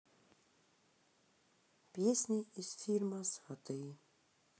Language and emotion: Russian, sad